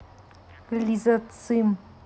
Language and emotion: Russian, neutral